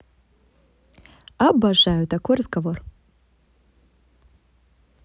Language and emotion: Russian, positive